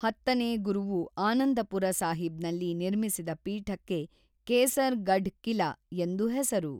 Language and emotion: Kannada, neutral